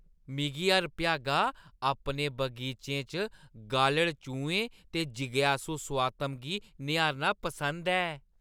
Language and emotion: Dogri, happy